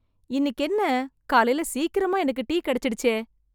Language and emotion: Tamil, surprised